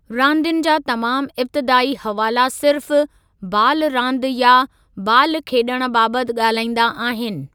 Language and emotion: Sindhi, neutral